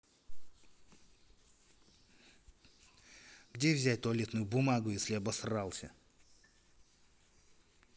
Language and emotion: Russian, angry